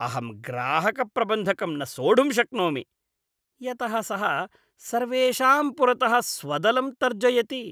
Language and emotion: Sanskrit, disgusted